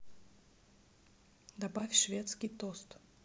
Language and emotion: Russian, neutral